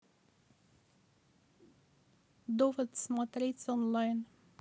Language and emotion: Russian, neutral